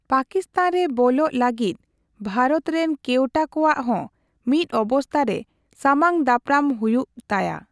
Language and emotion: Santali, neutral